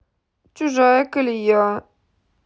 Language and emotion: Russian, sad